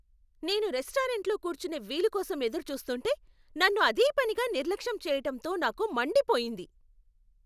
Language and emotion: Telugu, angry